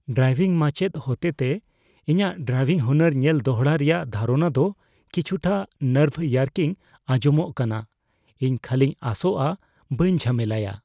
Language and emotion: Santali, fearful